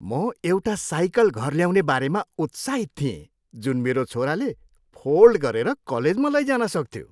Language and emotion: Nepali, happy